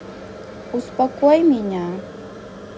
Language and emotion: Russian, neutral